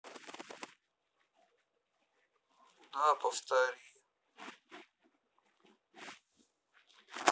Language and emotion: Russian, neutral